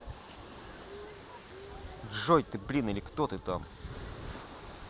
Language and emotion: Russian, angry